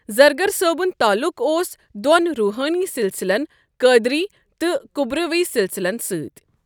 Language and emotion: Kashmiri, neutral